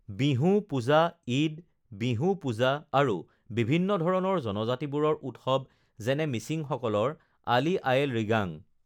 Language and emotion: Assamese, neutral